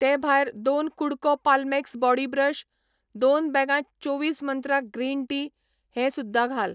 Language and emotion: Goan Konkani, neutral